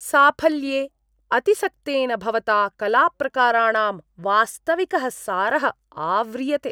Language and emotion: Sanskrit, disgusted